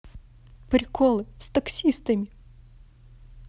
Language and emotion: Russian, positive